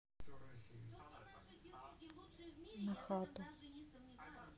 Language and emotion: Russian, neutral